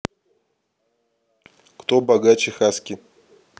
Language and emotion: Russian, neutral